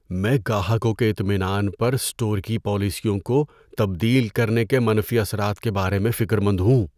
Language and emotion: Urdu, fearful